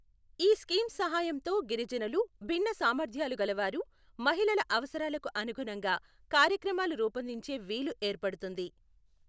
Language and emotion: Telugu, neutral